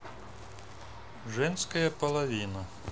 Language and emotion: Russian, neutral